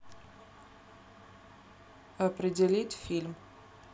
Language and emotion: Russian, neutral